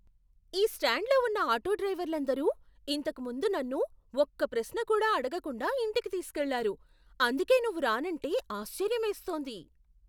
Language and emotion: Telugu, surprised